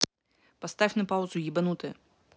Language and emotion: Russian, angry